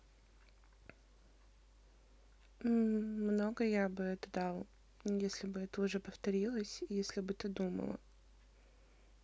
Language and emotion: Russian, neutral